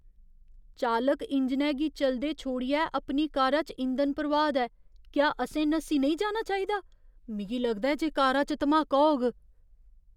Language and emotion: Dogri, fearful